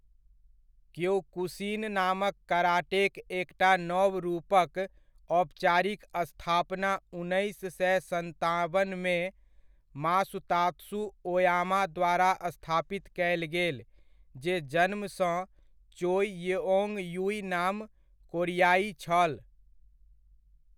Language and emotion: Maithili, neutral